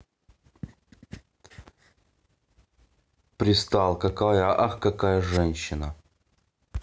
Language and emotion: Russian, neutral